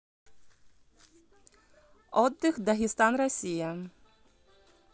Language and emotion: Russian, neutral